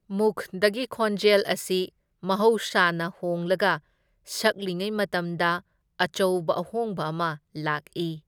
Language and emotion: Manipuri, neutral